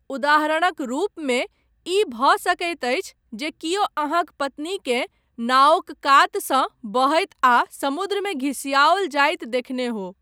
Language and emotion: Maithili, neutral